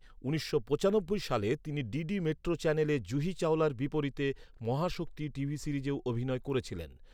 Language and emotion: Bengali, neutral